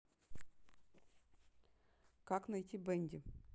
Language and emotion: Russian, neutral